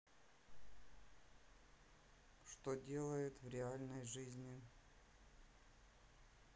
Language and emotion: Russian, neutral